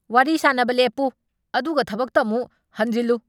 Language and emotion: Manipuri, angry